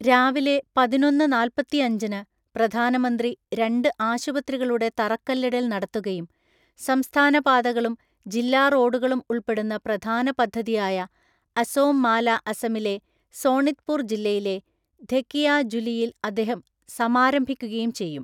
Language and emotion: Malayalam, neutral